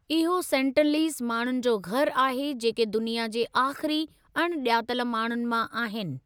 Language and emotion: Sindhi, neutral